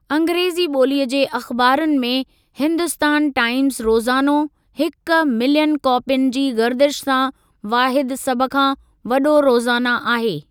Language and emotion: Sindhi, neutral